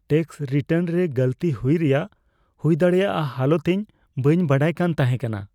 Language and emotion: Santali, fearful